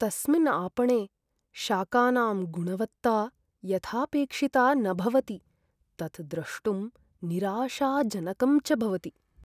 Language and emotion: Sanskrit, sad